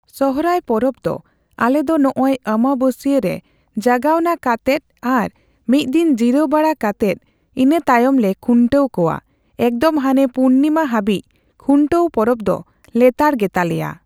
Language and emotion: Santali, neutral